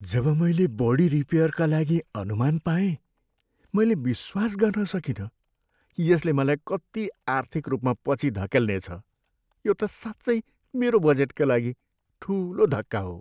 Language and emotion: Nepali, sad